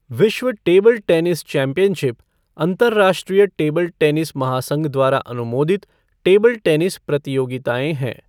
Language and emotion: Hindi, neutral